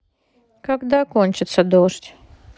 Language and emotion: Russian, sad